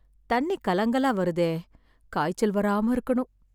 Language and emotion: Tamil, sad